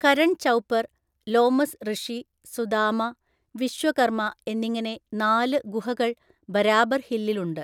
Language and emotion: Malayalam, neutral